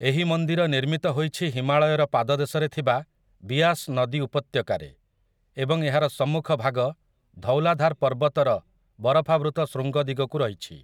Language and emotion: Odia, neutral